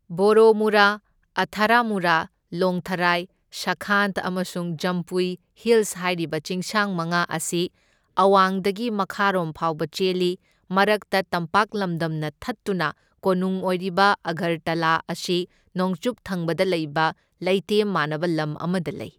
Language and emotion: Manipuri, neutral